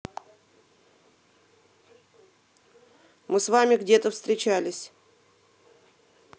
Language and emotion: Russian, neutral